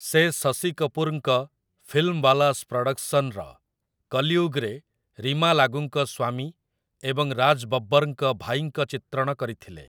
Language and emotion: Odia, neutral